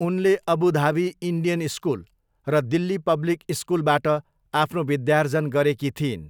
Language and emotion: Nepali, neutral